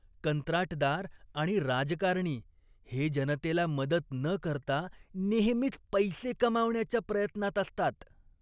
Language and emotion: Marathi, disgusted